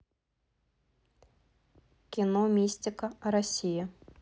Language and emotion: Russian, neutral